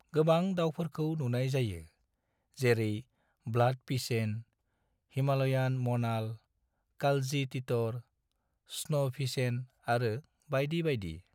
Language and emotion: Bodo, neutral